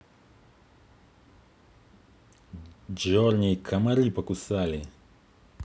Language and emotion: Russian, neutral